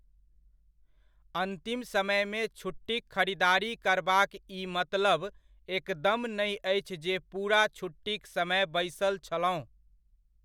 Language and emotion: Maithili, neutral